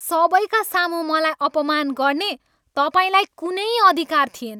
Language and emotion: Nepali, angry